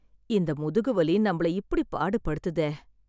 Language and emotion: Tamil, sad